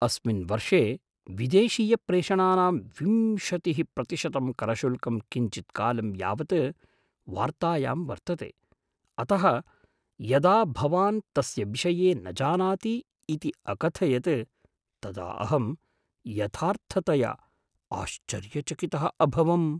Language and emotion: Sanskrit, surprised